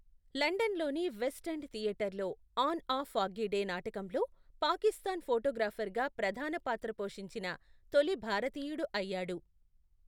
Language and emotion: Telugu, neutral